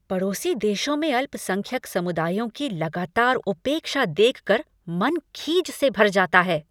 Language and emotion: Hindi, angry